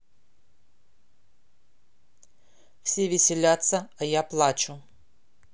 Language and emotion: Russian, neutral